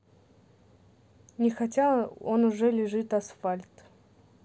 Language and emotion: Russian, neutral